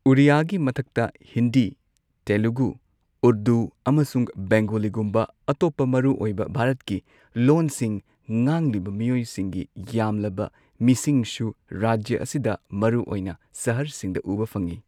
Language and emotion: Manipuri, neutral